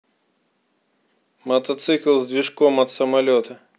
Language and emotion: Russian, neutral